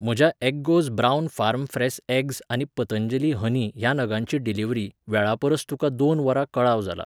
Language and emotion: Goan Konkani, neutral